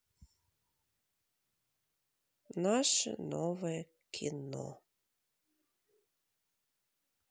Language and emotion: Russian, neutral